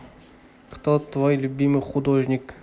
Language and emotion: Russian, neutral